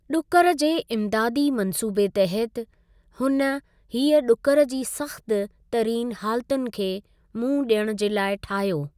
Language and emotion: Sindhi, neutral